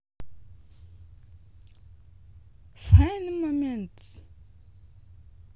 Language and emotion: Russian, neutral